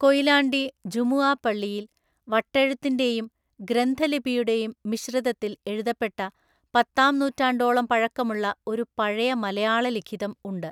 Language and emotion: Malayalam, neutral